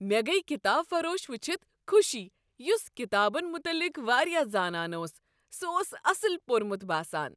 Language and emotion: Kashmiri, happy